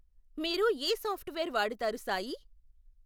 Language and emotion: Telugu, neutral